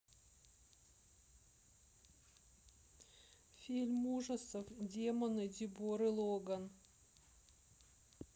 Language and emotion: Russian, sad